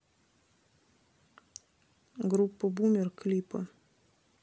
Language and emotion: Russian, neutral